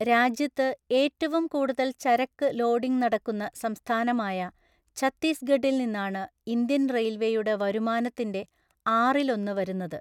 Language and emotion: Malayalam, neutral